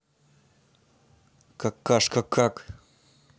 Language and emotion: Russian, neutral